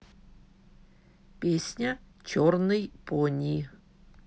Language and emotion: Russian, neutral